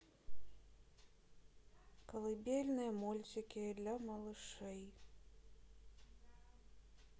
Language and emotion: Russian, neutral